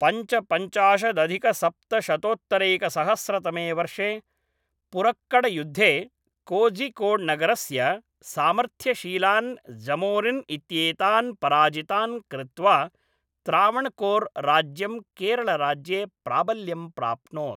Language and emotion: Sanskrit, neutral